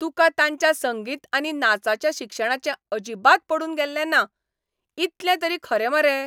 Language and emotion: Goan Konkani, angry